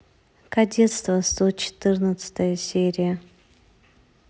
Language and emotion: Russian, neutral